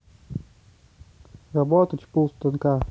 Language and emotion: Russian, neutral